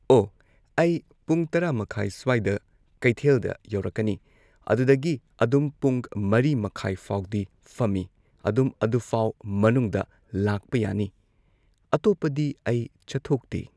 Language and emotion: Manipuri, neutral